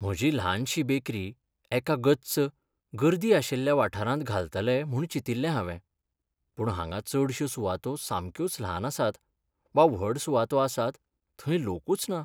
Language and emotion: Goan Konkani, sad